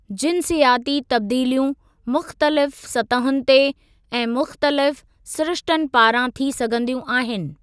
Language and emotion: Sindhi, neutral